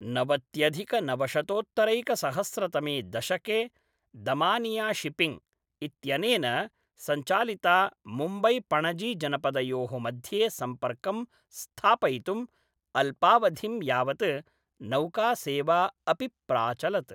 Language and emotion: Sanskrit, neutral